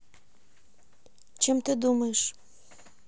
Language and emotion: Russian, neutral